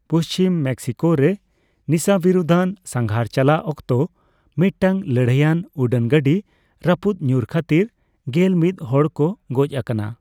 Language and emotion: Santali, neutral